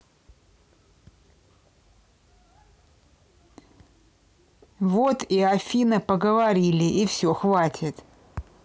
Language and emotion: Russian, angry